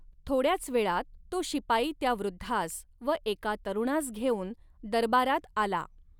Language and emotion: Marathi, neutral